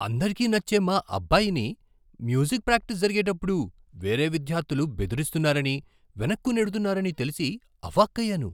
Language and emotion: Telugu, surprised